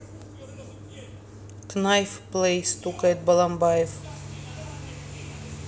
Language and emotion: Russian, neutral